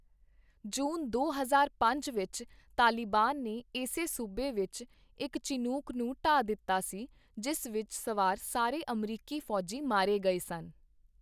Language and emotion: Punjabi, neutral